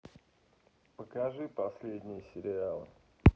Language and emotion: Russian, neutral